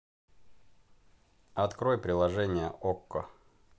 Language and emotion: Russian, neutral